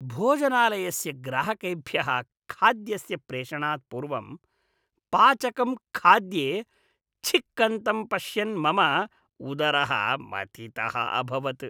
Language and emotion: Sanskrit, disgusted